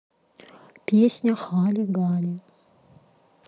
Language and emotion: Russian, neutral